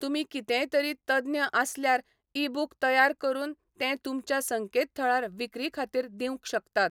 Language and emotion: Goan Konkani, neutral